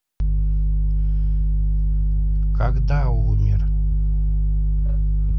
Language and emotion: Russian, neutral